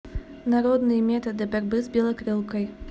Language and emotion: Russian, neutral